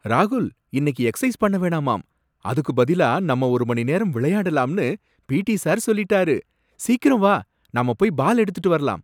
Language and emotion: Tamil, surprised